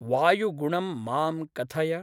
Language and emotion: Sanskrit, neutral